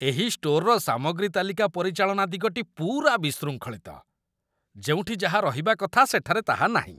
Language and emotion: Odia, disgusted